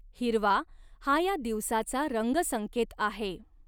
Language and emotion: Marathi, neutral